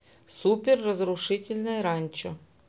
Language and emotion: Russian, neutral